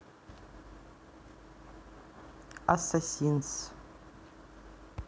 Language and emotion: Russian, neutral